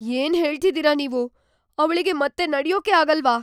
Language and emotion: Kannada, fearful